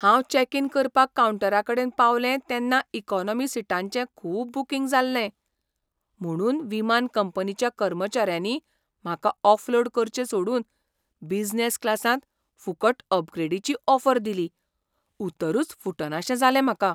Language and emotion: Goan Konkani, surprised